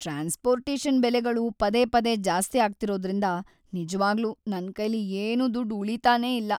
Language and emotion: Kannada, sad